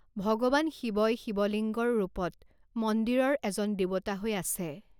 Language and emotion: Assamese, neutral